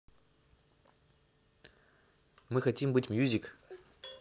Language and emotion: Russian, neutral